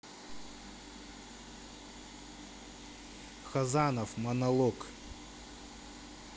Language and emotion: Russian, neutral